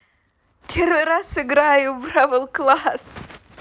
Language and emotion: Russian, positive